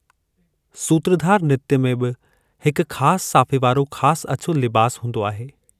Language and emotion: Sindhi, neutral